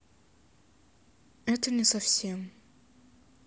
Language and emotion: Russian, sad